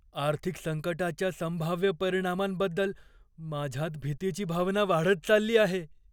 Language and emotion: Marathi, fearful